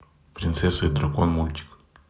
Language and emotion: Russian, neutral